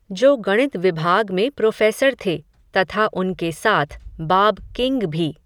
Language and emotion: Hindi, neutral